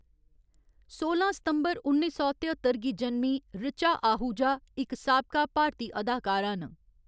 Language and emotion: Dogri, neutral